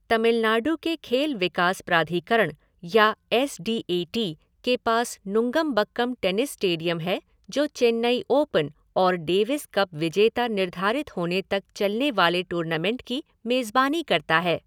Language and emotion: Hindi, neutral